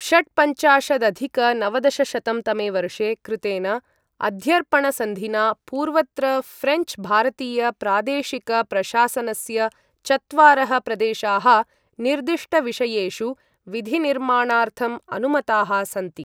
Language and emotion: Sanskrit, neutral